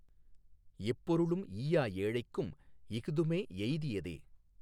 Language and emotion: Tamil, neutral